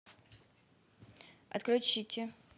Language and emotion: Russian, neutral